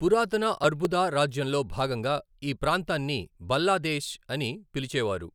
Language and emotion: Telugu, neutral